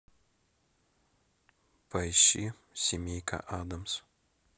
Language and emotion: Russian, neutral